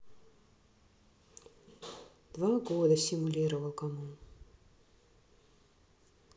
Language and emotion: Russian, sad